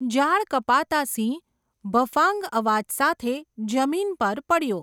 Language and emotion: Gujarati, neutral